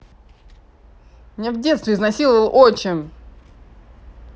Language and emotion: Russian, angry